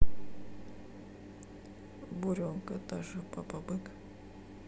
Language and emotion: Russian, sad